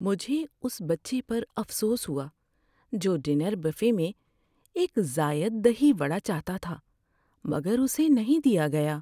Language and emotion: Urdu, sad